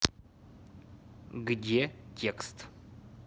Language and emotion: Russian, neutral